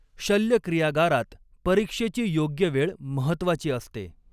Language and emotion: Marathi, neutral